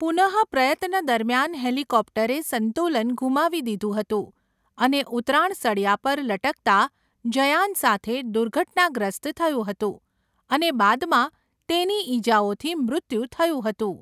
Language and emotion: Gujarati, neutral